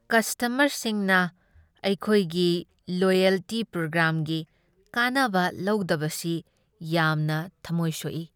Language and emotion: Manipuri, sad